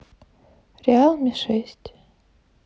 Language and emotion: Russian, neutral